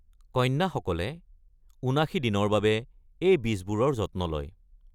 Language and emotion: Assamese, neutral